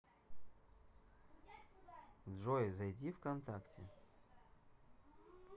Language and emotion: Russian, neutral